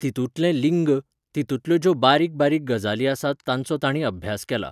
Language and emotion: Goan Konkani, neutral